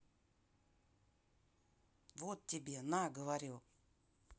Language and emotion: Russian, neutral